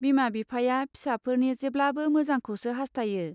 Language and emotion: Bodo, neutral